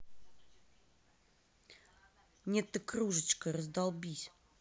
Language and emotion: Russian, angry